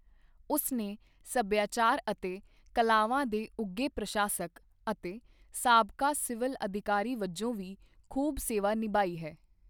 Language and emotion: Punjabi, neutral